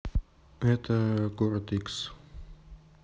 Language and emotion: Russian, neutral